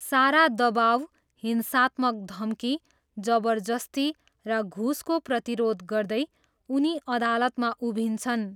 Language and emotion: Nepali, neutral